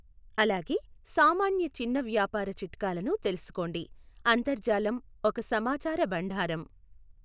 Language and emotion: Telugu, neutral